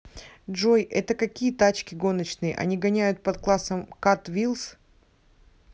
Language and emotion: Russian, neutral